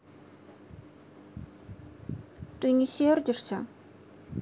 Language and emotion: Russian, sad